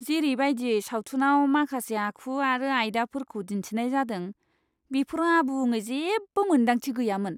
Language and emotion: Bodo, disgusted